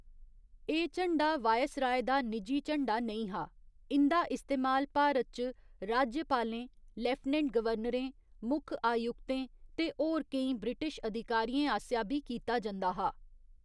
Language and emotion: Dogri, neutral